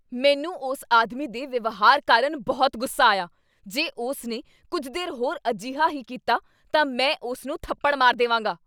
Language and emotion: Punjabi, angry